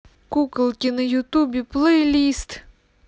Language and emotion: Russian, neutral